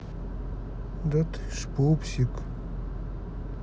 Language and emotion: Russian, sad